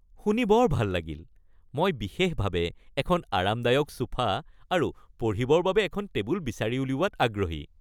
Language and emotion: Assamese, happy